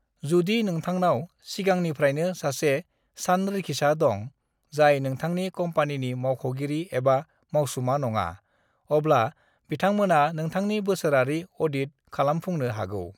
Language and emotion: Bodo, neutral